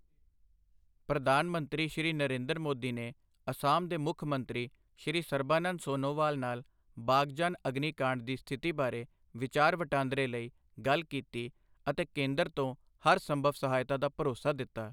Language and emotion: Punjabi, neutral